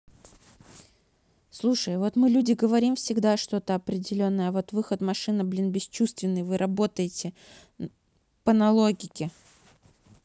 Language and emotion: Russian, neutral